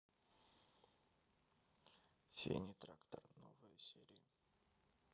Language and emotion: Russian, sad